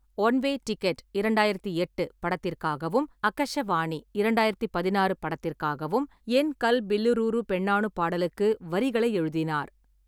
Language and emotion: Tamil, neutral